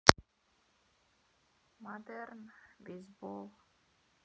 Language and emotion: Russian, sad